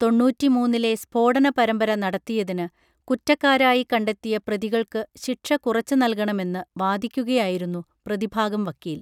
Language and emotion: Malayalam, neutral